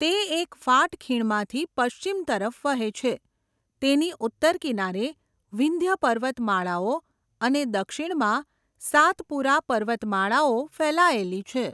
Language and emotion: Gujarati, neutral